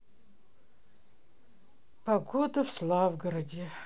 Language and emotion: Russian, sad